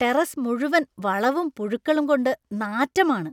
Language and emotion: Malayalam, disgusted